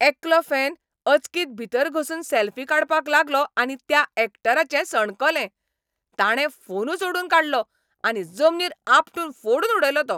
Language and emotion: Goan Konkani, angry